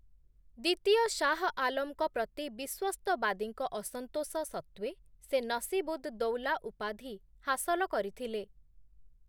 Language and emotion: Odia, neutral